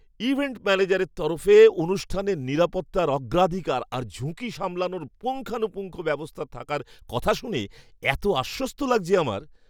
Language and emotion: Bengali, happy